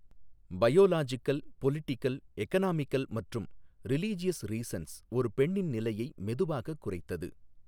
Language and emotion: Tamil, neutral